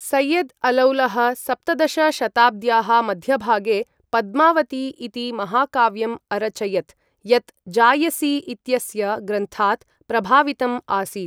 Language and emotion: Sanskrit, neutral